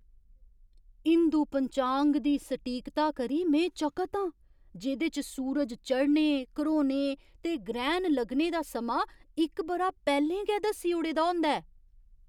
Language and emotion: Dogri, surprised